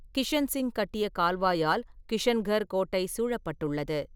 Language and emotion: Tamil, neutral